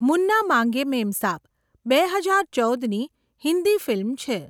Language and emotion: Gujarati, neutral